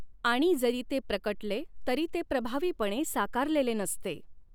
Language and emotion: Marathi, neutral